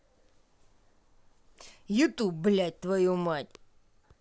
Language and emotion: Russian, angry